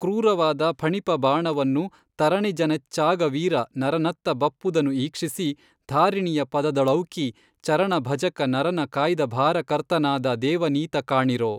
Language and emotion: Kannada, neutral